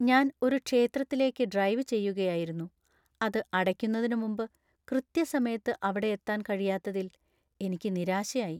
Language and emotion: Malayalam, sad